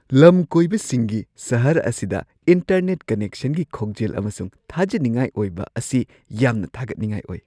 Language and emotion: Manipuri, surprised